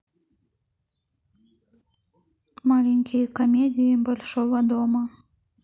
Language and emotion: Russian, neutral